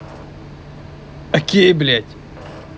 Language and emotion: Russian, angry